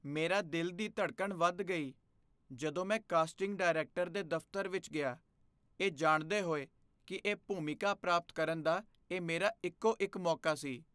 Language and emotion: Punjabi, fearful